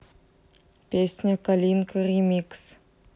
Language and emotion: Russian, neutral